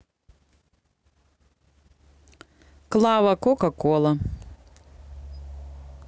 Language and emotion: Russian, neutral